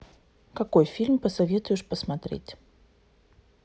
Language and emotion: Russian, neutral